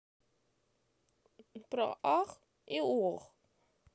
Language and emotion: Russian, sad